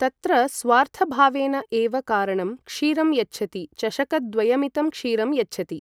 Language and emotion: Sanskrit, neutral